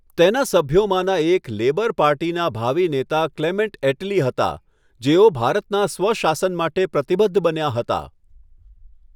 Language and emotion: Gujarati, neutral